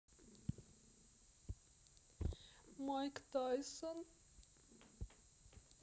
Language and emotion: Russian, sad